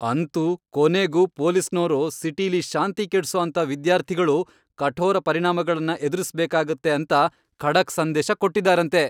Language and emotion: Kannada, happy